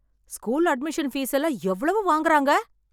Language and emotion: Tamil, angry